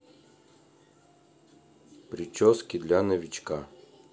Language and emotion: Russian, neutral